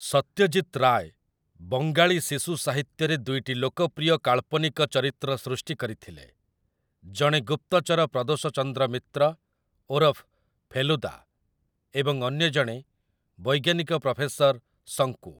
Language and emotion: Odia, neutral